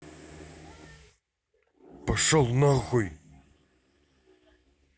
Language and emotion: Russian, angry